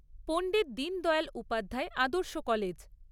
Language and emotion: Bengali, neutral